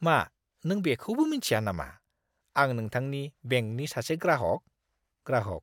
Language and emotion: Bodo, disgusted